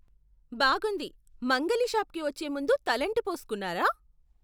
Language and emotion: Telugu, surprised